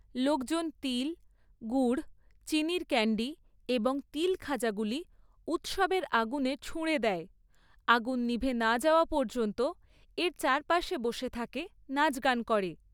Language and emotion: Bengali, neutral